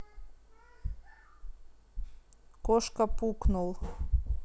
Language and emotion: Russian, neutral